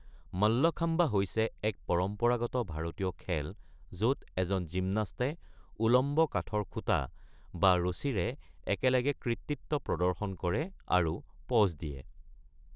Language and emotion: Assamese, neutral